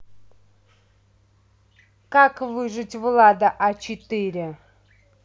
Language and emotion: Russian, neutral